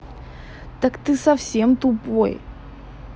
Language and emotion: Russian, angry